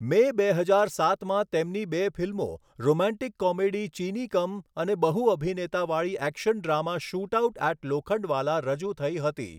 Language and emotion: Gujarati, neutral